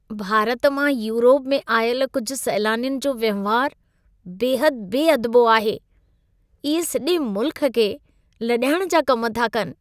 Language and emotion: Sindhi, disgusted